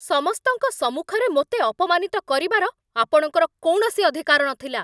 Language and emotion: Odia, angry